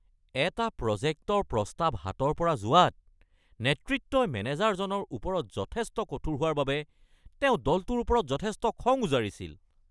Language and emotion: Assamese, angry